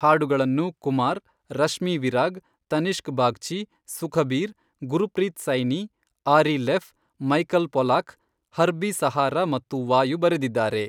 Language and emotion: Kannada, neutral